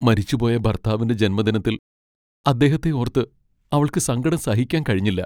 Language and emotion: Malayalam, sad